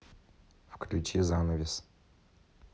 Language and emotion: Russian, neutral